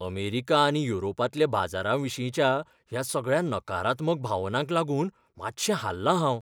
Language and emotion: Goan Konkani, fearful